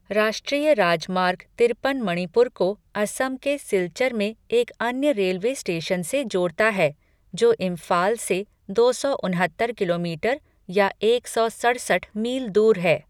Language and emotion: Hindi, neutral